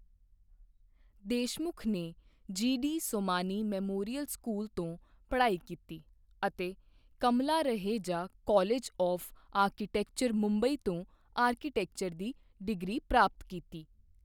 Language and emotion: Punjabi, neutral